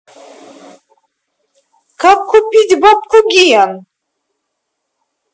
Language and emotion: Russian, angry